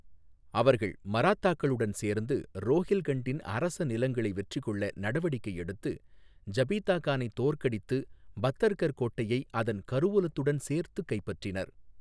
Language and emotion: Tamil, neutral